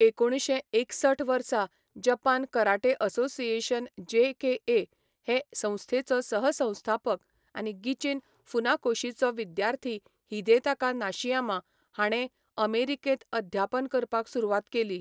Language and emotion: Goan Konkani, neutral